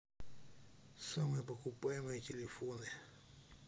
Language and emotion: Russian, neutral